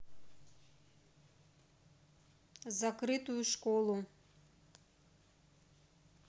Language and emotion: Russian, neutral